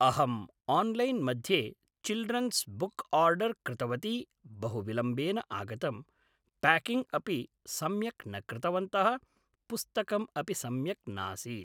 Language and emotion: Sanskrit, neutral